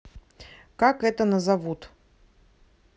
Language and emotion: Russian, neutral